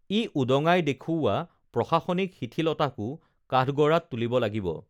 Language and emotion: Assamese, neutral